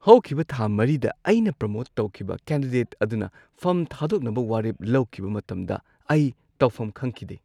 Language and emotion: Manipuri, surprised